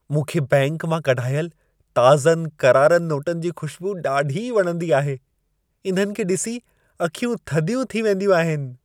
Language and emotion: Sindhi, happy